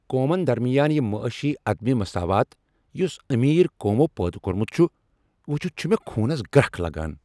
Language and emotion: Kashmiri, angry